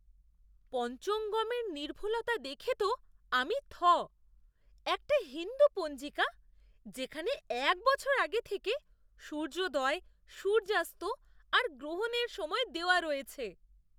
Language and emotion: Bengali, surprised